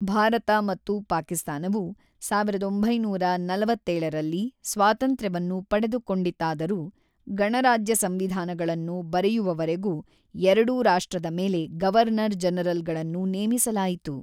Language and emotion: Kannada, neutral